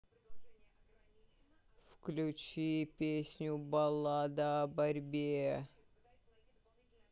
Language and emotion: Russian, angry